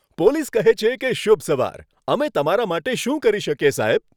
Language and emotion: Gujarati, happy